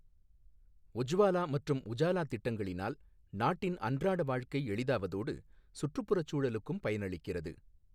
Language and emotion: Tamil, neutral